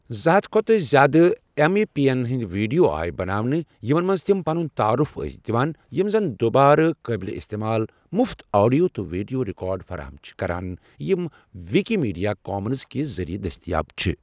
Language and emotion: Kashmiri, neutral